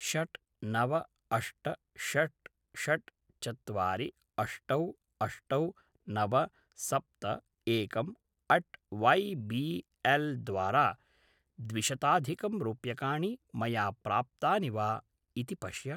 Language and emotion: Sanskrit, neutral